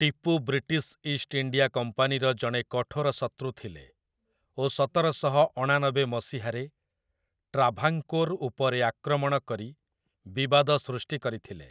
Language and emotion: Odia, neutral